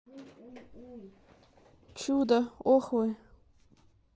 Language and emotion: Russian, neutral